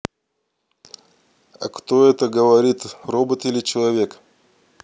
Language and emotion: Russian, neutral